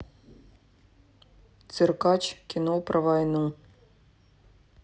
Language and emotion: Russian, neutral